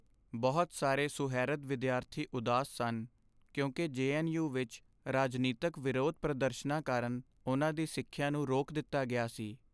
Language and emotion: Punjabi, sad